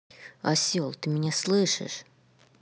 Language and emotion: Russian, angry